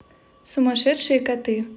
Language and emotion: Russian, neutral